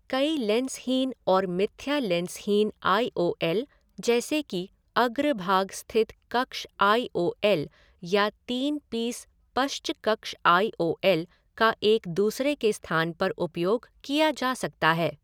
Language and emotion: Hindi, neutral